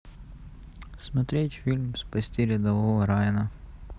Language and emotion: Russian, neutral